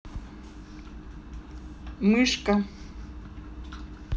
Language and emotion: Russian, neutral